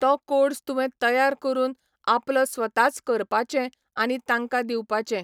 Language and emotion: Goan Konkani, neutral